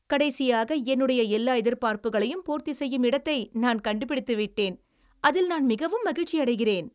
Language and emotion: Tamil, happy